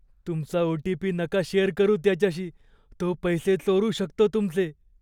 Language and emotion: Marathi, fearful